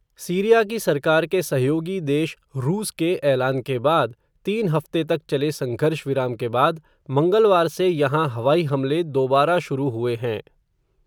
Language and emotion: Hindi, neutral